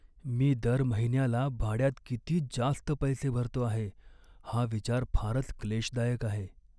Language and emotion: Marathi, sad